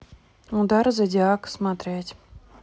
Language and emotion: Russian, neutral